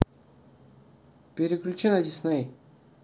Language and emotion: Russian, neutral